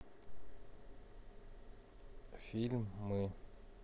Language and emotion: Russian, neutral